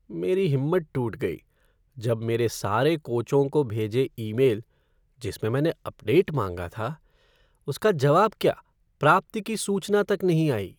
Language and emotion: Hindi, sad